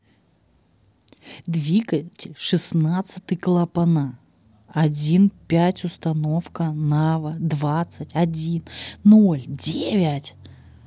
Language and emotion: Russian, neutral